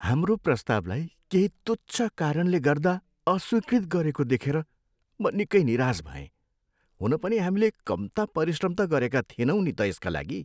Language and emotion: Nepali, sad